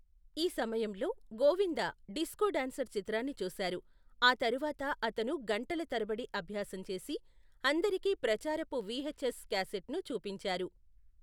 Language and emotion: Telugu, neutral